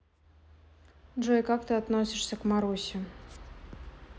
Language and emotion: Russian, neutral